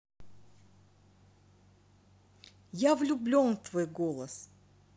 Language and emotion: Russian, positive